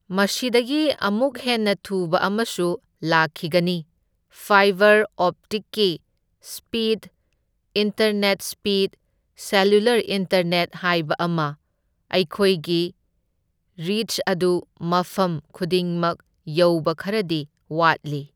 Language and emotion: Manipuri, neutral